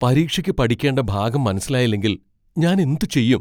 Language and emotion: Malayalam, fearful